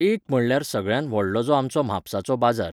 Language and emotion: Goan Konkani, neutral